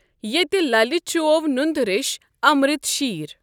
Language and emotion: Kashmiri, neutral